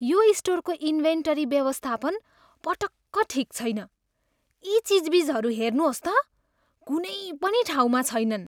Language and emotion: Nepali, disgusted